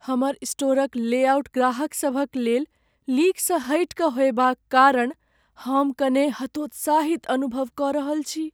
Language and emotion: Maithili, sad